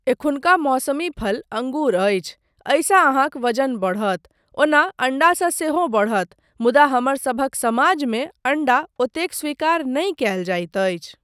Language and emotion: Maithili, neutral